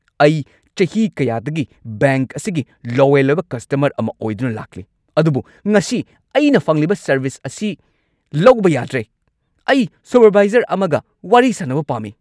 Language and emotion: Manipuri, angry